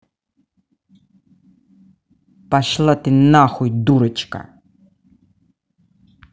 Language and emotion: Russian, angry